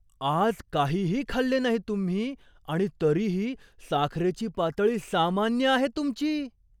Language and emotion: Marathi, surprised